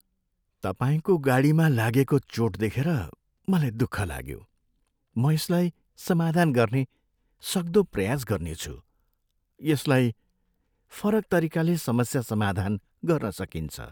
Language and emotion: Nepali, sad